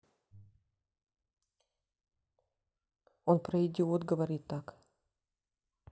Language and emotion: Russian, sad